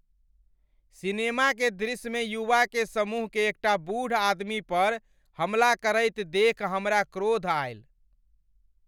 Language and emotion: Maithili, angry